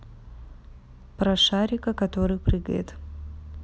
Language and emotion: Russian, neutral